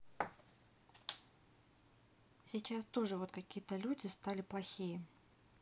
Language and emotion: Russian, neutral